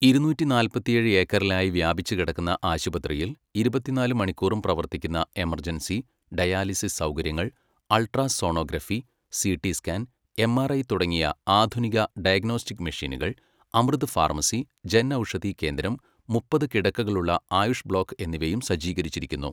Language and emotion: Malayalam, neutral